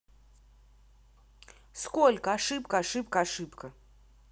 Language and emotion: Russian, angry